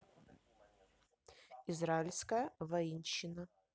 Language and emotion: Russian, neutral